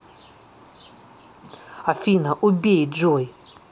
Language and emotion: Russian, angry